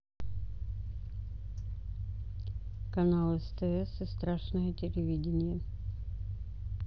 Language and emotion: Russian, neutral